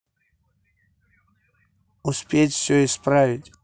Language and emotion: Russian, neutral